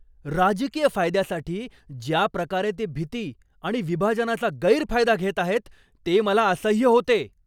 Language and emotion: Marathi, angry